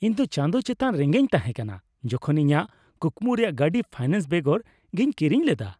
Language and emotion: Santali, happy